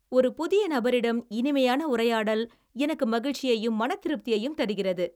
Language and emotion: Tamil, happy